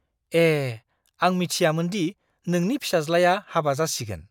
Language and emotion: Bodo, surprised